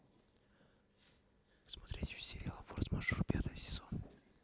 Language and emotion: Russian, neutral